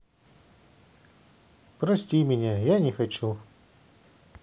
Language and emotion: Russian, sad